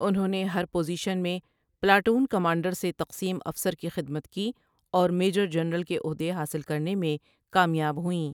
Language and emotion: Urdu, neutral